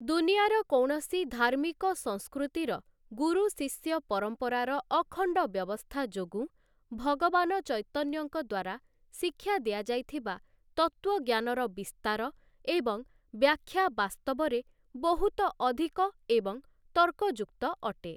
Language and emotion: Odia, neutral